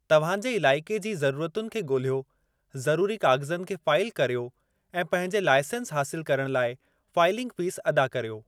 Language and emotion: Sindhi, neutral